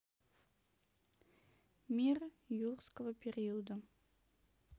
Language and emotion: Russian, neutral